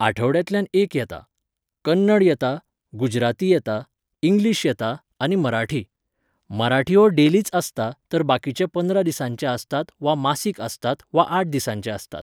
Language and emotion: Goan Konkani, neutral